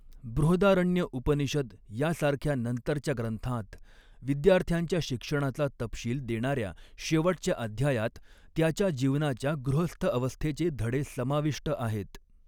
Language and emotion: Marathi, neutral